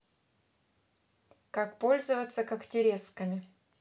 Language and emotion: Russian, neutral